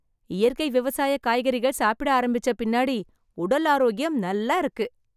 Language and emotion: Tamil, happy